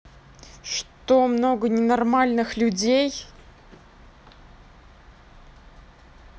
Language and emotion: Russian, angry